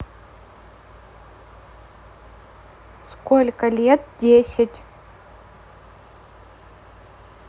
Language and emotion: Russian, neutral